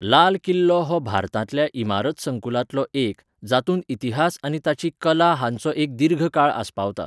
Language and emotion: Goan Konkani, neutral